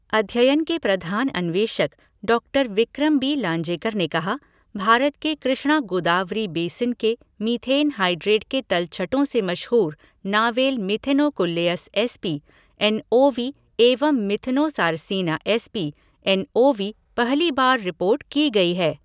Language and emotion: Hindi, neutral